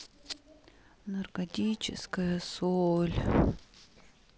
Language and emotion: Russian, sad